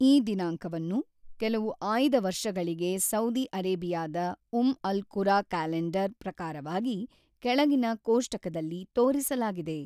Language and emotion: Kannada, neutral